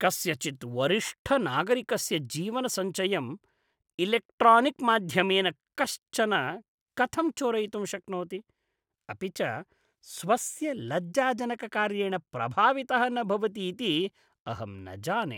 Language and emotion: Sanskrit, disgusted